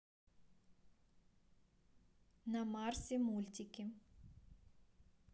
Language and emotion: Russian, neutral